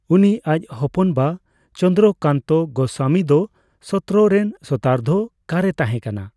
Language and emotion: Santali, neutral